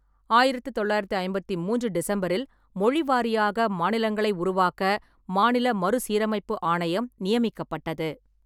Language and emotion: Tamil, neutral